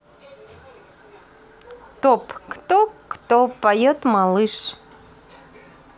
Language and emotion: Russian, positive